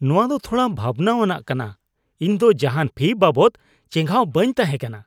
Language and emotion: Santali, disgusted